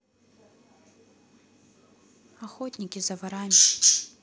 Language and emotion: Russian, neutral